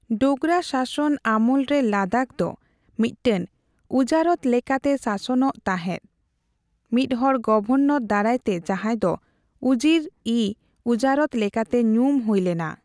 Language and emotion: Santali, neutral